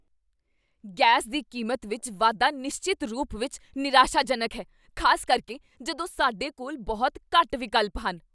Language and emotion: Punjabi, angry